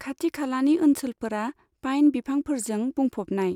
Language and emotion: Bodo, neutral